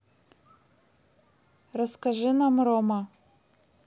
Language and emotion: Russian, neutral